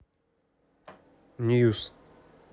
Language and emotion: Russian, neutral